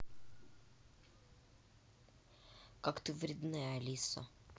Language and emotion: Russian, neutral